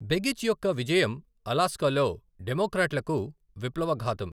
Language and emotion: Telugu, neutral